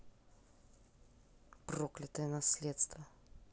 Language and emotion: Russian, angry